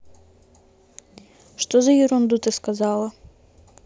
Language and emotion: Russian, neutral